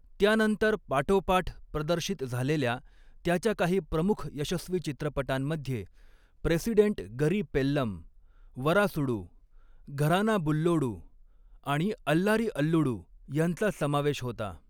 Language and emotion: Marathi, neutral